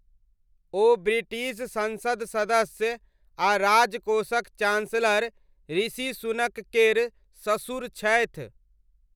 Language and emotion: Maithili, neutral